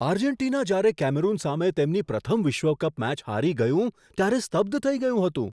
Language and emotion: Gujarati, surprised